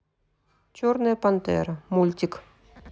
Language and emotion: Russian, neutral